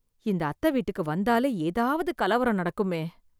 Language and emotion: Tamil, fearful